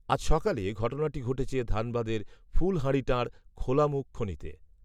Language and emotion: Bengali, neutral